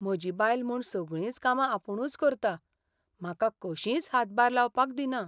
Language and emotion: Goan Konkani, sad